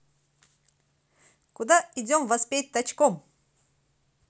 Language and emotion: Russian, positive